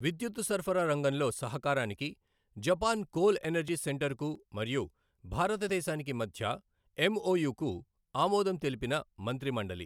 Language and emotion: Telugu, neutral